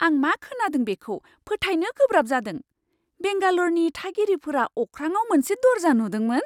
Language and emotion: Bodo, surprised